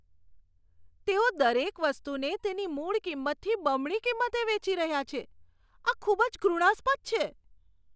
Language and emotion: Gujarati, disgusted